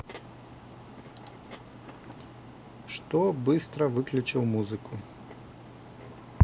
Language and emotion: Russian, neutral